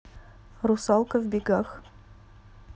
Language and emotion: Russian, neutral